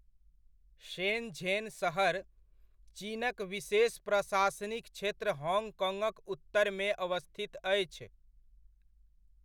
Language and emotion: Maithili, neutral